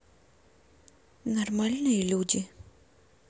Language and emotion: Russian, neutral